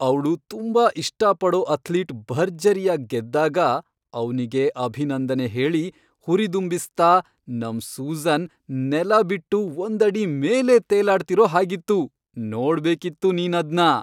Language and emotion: Kannada, happy